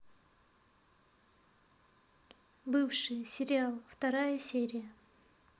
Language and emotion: Russian, neutral